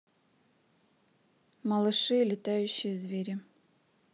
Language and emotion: Russian, neutral